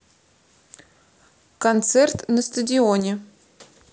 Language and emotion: Russian, neutral